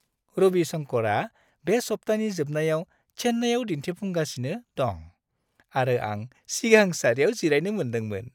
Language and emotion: Bodo, happy